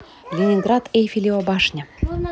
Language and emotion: Russian, neutral